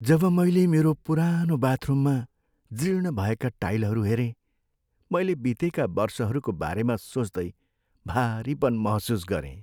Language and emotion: Nepali, sad